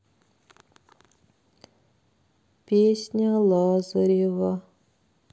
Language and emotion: Russian, sad